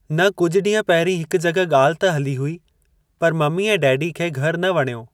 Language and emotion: Sindhi, neutral